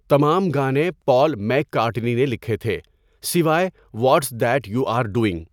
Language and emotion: Urdu, neutral